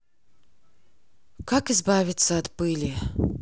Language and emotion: Russian, neutral